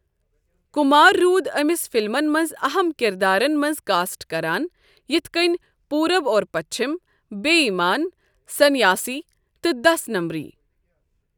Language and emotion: Kashmiri, neutral